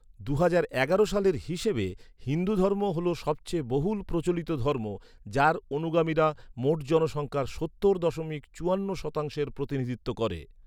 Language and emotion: Bengali, neutral